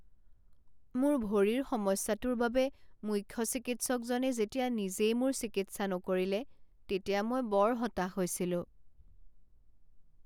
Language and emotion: Assamese, sad